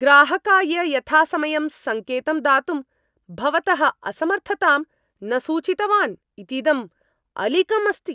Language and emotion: Sanskrit, angry